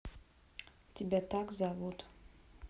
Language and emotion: Russian, neutral